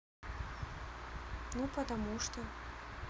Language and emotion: Russian, neutral